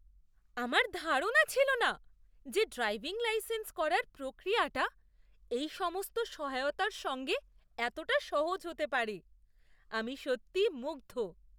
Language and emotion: Bengali, surprised